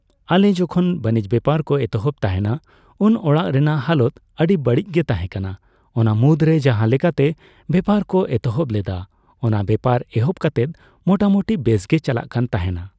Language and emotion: Santali, neutral